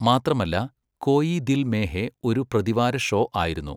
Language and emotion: Malayalam, neutral